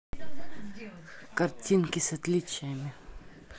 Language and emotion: Russian, neutral